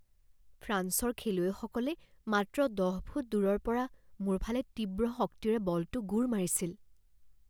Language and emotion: Assamese, fearful